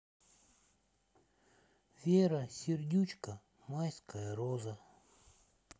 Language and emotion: Russian, sad